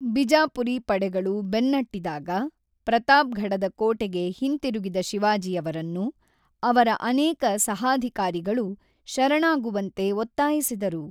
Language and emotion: Kannada, neutral